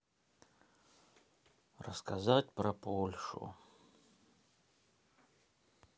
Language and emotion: Russian, sad